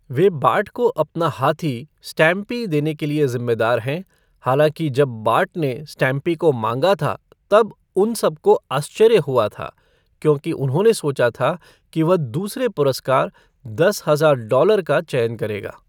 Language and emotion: Hindi, neutral